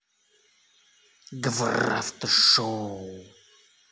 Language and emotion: Russian, angry